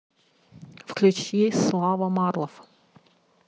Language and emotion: Russian, neutral